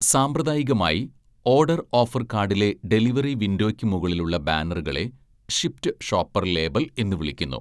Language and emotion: Malayalam, neutral